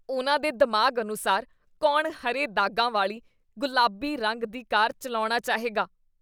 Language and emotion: Punjabi, disgusted